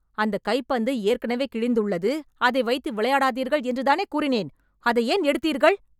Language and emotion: Tamil, angry